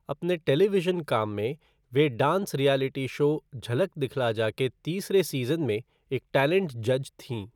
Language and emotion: Hindi, neutral